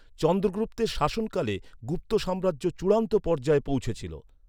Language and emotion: Bengali, neutral